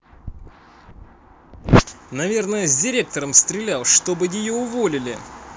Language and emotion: Russian, positive